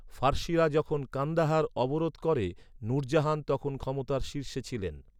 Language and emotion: Bengali, neutral